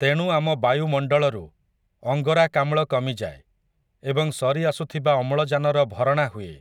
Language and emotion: Odia, neutral